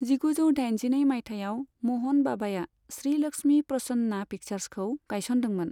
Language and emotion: Bodo, neutral